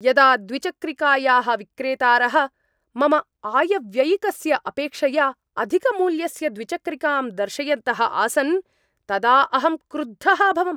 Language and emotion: Sanskrit, angry